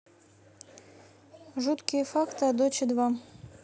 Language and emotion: Russian, neutral